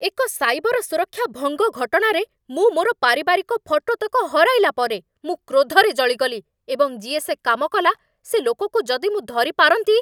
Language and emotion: Odia, angry